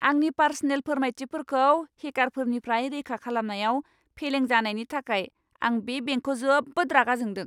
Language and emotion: Bodo, angry